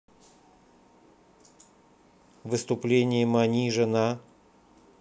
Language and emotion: Russian, neutral